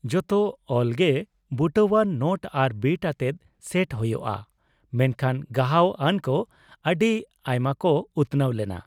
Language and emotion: Santali, neutral